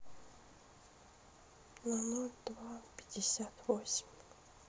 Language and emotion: Russian, sad